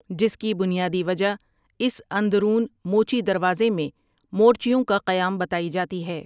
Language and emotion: Urdu, neutral